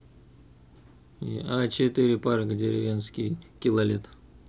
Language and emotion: Russian, neutral